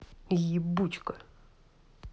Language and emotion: Russian, angry